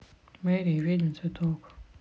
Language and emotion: Russian, sad